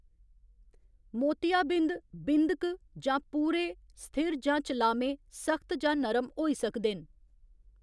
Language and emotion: Dogri, neutral